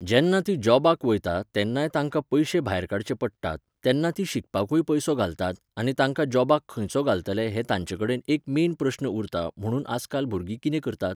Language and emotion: Goan Konkani, neutral